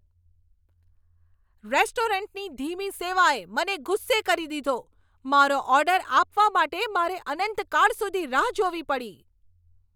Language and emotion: Gujarati, angry